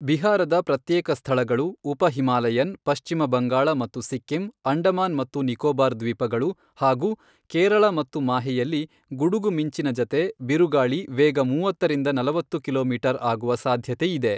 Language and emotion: Kannada, neutral